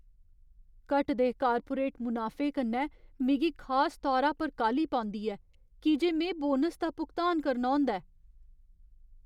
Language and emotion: Dogri, fearful